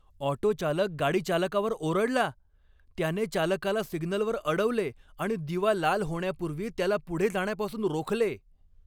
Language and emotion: Marathi, angry